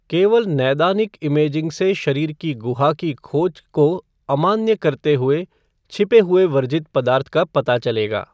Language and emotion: Hindi, neutral